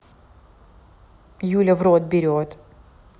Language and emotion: Russian, neutral